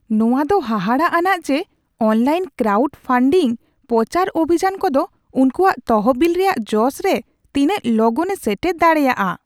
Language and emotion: Santali, surprised